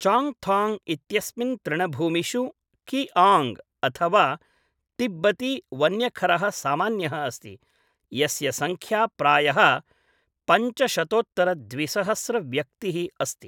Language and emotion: Sanskrit, neutral